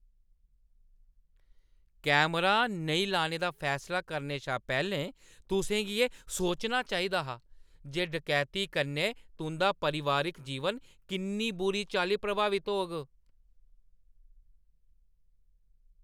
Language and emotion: Dogri, angry